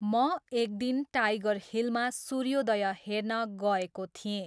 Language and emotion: Nepali, neutral